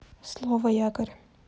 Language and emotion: Russian, neutral